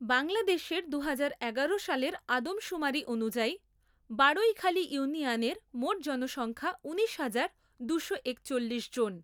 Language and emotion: Bengali, neutral